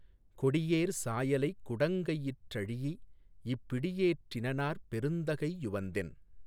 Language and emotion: Tamil, neutral